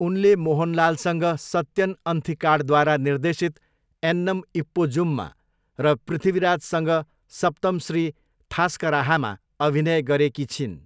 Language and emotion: Nepali, neutral